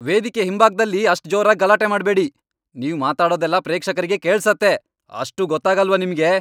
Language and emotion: Kannada, angry